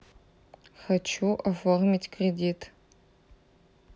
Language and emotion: Russian, neutral